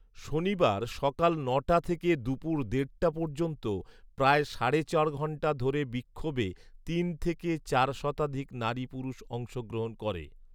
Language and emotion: Bengali, neutral